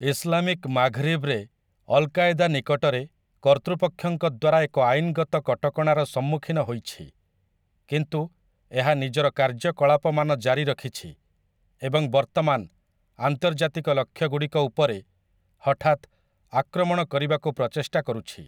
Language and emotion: Odia, neutral